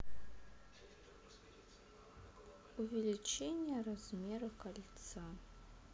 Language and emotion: Russian, neutral